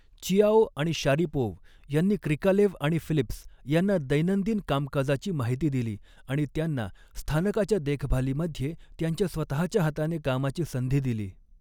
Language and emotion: Marathi, neutral